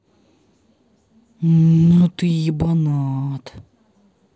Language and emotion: Russian, angry